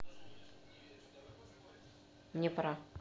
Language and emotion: Russian, neutral